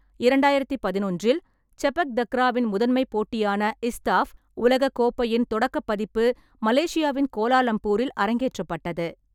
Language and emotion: Tamil, neutral